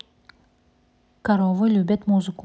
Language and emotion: Russian, neutral